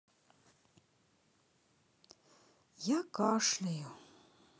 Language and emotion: Russian, sad